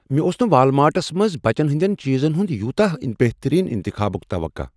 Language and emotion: Kashmiri, surprised